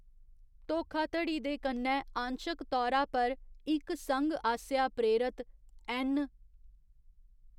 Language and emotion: Dogri, neutral